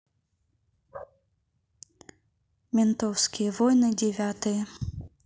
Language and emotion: Russian, neutral